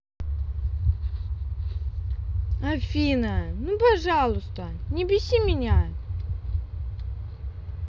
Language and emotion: Russian, angry